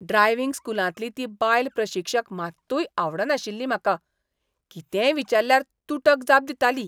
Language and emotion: Goan Konkani, disgusted